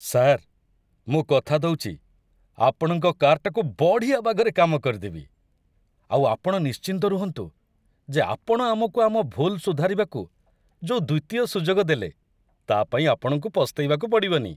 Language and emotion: Odia, happy